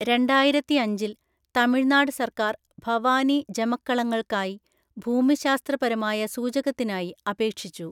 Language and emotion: Malayalam, neutral